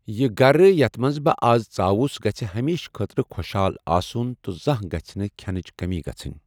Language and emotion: Kashmiri, neutral